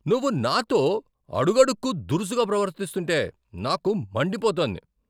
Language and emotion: Telugu, angry